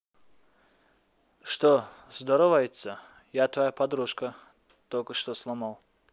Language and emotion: Russian, neutral